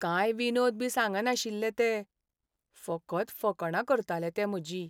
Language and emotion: Goan Konkani, sad